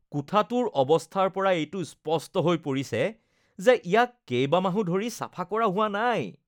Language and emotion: Assamese, disgusted